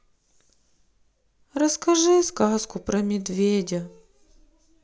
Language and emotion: Russian, sad